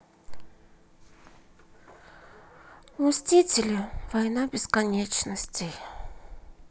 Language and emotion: Russian, sad